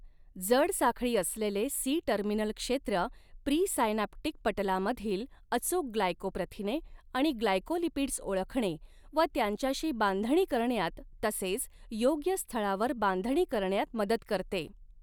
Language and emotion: Marathi, neutral